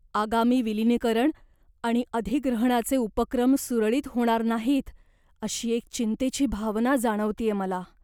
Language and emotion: Marathi, fearful